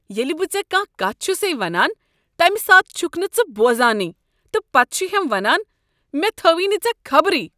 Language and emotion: Kashmiri, disgusted